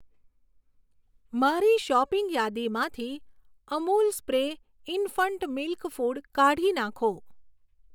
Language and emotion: Gujarati, neutral